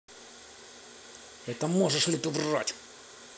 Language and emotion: Russian, angry